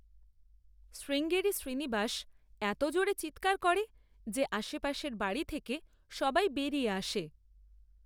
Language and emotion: Bengali, neutral